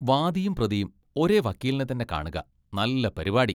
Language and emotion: Malayalam, disgusted